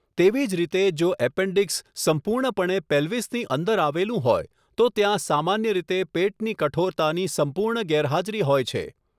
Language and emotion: Gujarati, neutral